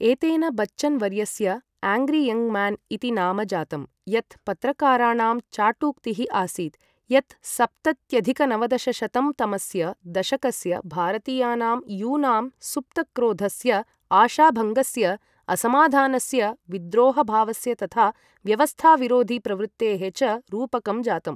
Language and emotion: Sanskrit, neutral